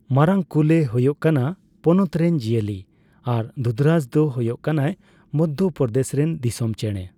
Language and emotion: Santali, neutral